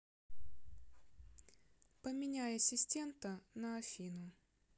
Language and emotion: Russian, neutral